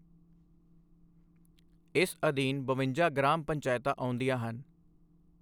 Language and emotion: Punjabi, neutral